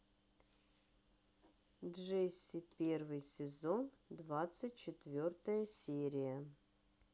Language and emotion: Russian, neutral